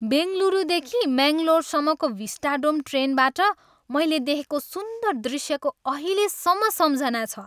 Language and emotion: Nepali, happy